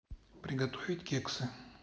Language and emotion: Russian, neutral